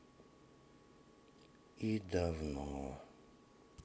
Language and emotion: Russian, sad